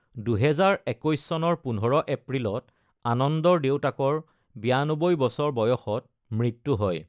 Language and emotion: Assamese, neutral